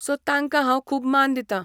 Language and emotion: Goan Konkani, neutral